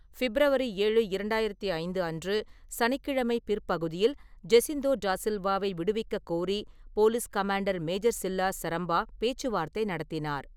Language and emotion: Tamil, neutral